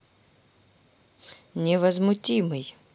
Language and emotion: Russian, neutral